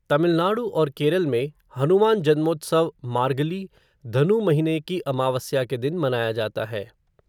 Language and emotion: Hindi, neutral